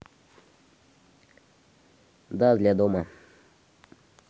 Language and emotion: Russian, neutral